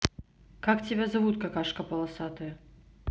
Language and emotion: Russian, neutral